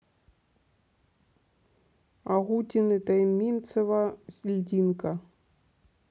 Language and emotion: Russian, neutral